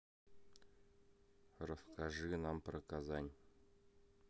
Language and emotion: Russian, neutral